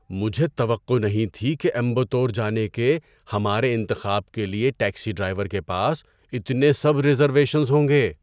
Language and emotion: Urdu, surprised